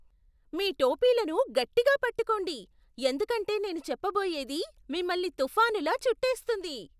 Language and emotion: Telugu, surprised